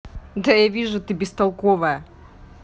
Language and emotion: Russian, neutral